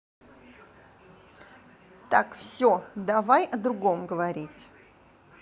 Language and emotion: Russian, angry